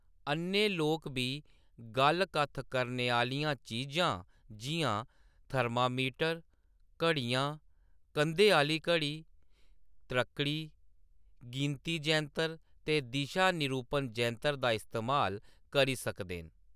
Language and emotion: Dogri, neutral